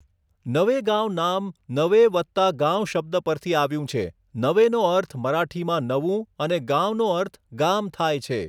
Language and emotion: Gujarati, neutral